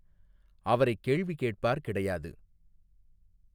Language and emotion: Tamil, neutral